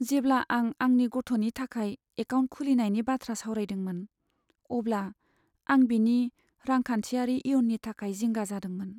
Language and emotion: Bodo, sad